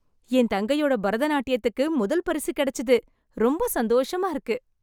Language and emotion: Tamil, happy